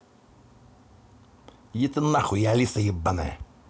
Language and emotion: Russian, angry